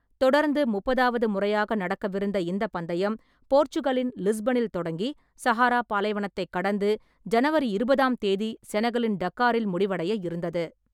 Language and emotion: Tamil, neutral